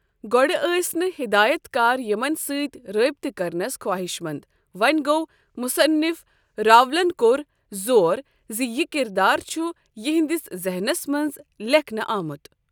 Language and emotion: Kashmiri, neutral